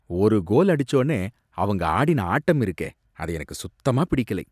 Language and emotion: Tamil, disgusted